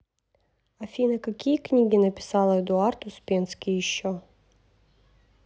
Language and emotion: Russian, neutral